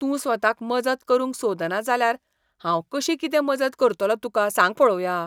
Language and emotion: Goan Konkani, disgusted